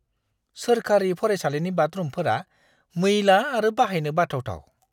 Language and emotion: Bodo, disgusted